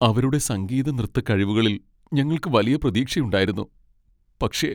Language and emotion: Malayalam, sad